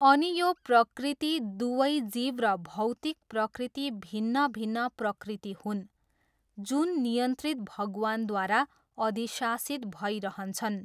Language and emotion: Nepali, neutral